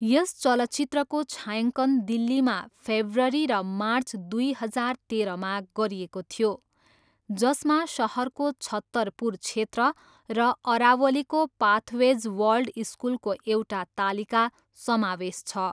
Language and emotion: Nepali, neutral